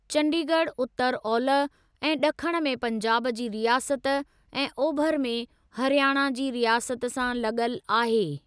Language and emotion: Sindhi, neutral